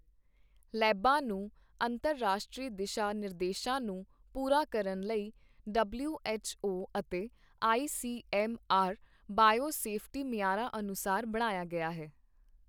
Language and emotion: Punjabi, neutral